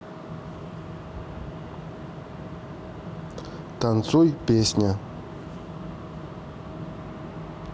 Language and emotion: Russian, neutral